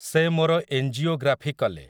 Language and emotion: Odia, neutral